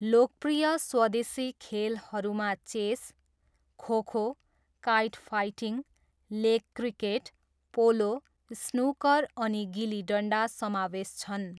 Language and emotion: Nepali, neutral